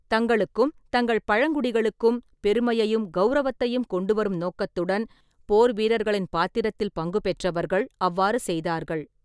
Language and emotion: Tamil, neutral